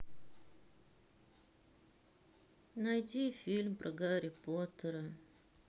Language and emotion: Russian, sad